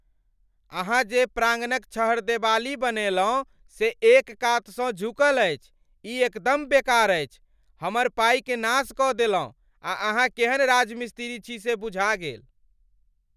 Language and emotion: Maithili, angry